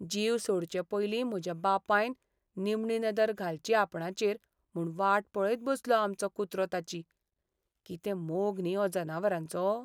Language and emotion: Goan Konkani, sad